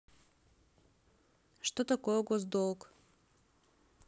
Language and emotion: Russian, neutral